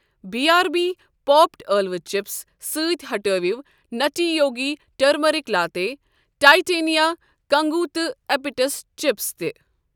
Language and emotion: Kashmiri, neutral